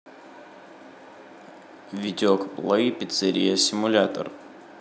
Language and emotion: Russian, neutral